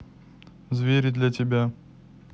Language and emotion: Russian, neutral